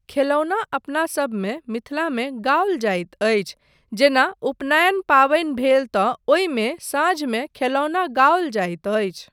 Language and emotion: Maithili, neutral